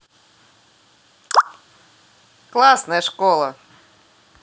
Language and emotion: Russian, positive